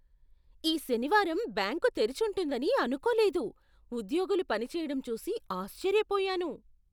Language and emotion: Telugu, surprised